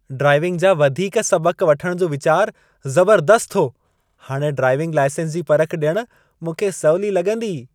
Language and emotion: Sindhi, happy